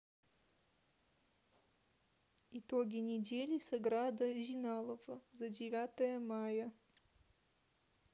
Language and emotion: Russian, neutral